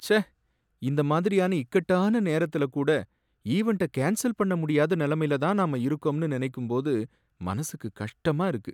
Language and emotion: Tamil, sad